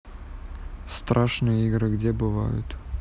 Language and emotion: Russian, neutral